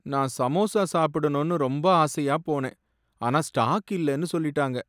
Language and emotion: Tamil, sad